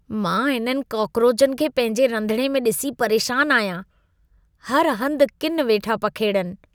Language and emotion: Sindhi, disgusted